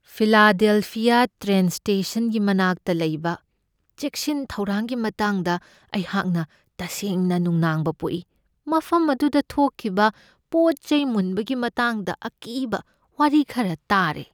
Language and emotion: Manipuri, fearful